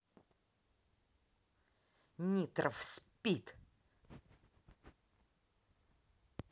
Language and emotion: Russian, angry